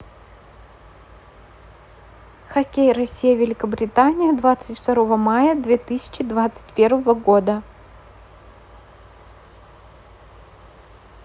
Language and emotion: Russian, neutral